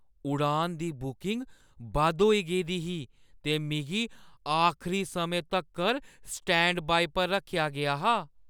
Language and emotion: Dogri, fearful